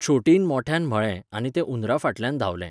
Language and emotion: Goan Konkani, neutral